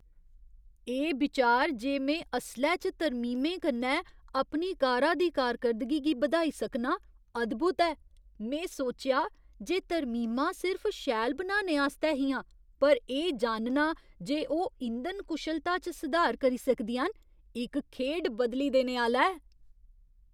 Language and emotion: Dogri, surprised